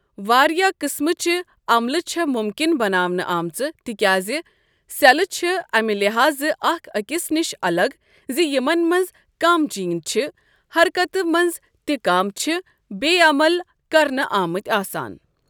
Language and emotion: Kashmiri, neutral